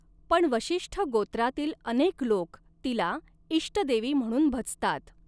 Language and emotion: Marathi, neutral